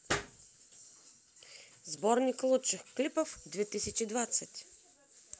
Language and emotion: Russian, positive